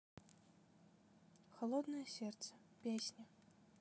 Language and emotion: Russian, neutral